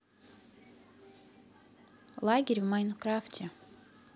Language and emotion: Russian, neutral